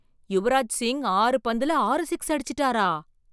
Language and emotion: Tamil, surprised